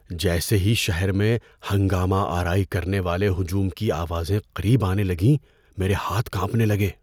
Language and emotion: Urdu, fearful